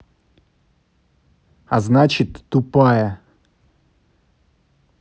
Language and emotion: Russian, angry